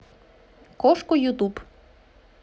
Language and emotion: Russian, positive